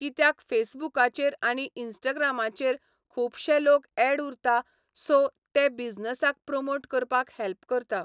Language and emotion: Goan Konkani, neutral